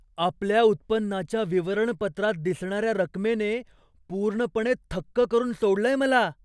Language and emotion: Marathi, surprised